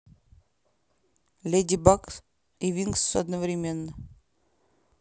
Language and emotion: Russian, neutral